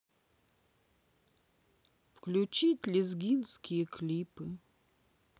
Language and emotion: Russian, sad